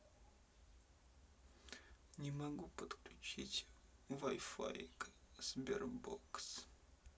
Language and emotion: Russian, sad